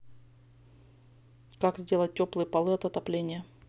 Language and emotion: Russian, neutral